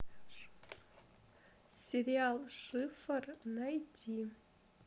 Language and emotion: Russian, neutral